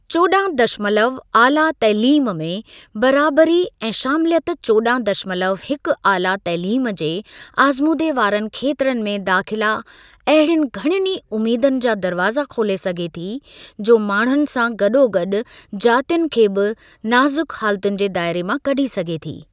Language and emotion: Sindhi, neutral